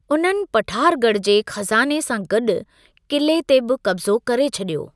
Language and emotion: Sindhi, neutral